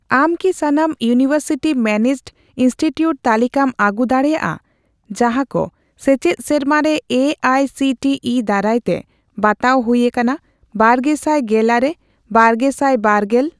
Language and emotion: Santali, neutral